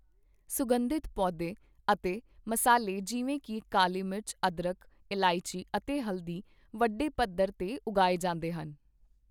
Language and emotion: Punjabi, neutral